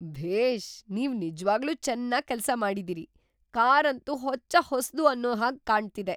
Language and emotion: Kannada, surprised